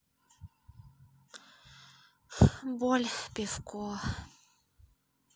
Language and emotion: Russian, sad